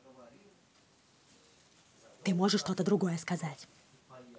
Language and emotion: Russian, angry